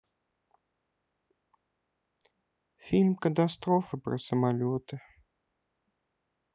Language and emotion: Russian, sad